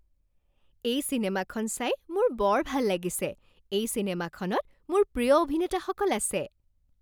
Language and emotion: Assamese, happy